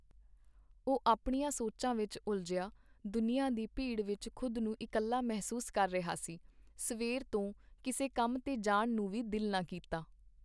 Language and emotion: Punjabi, neutral